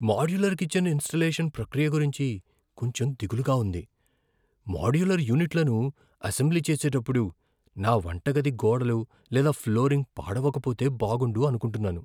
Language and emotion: Telugu, fearful